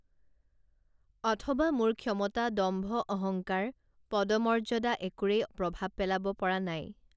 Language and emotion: Assamese, neutral